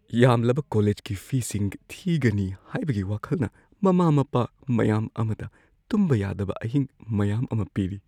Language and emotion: Manipuri, fearful